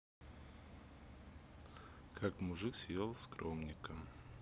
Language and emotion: Russian, neutral